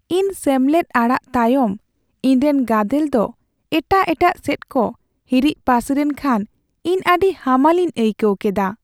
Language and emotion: Santali, sad